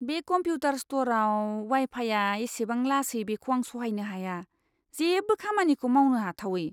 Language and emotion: Bodo, disgusted